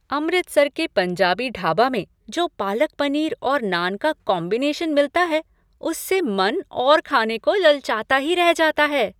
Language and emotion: Hindi, happy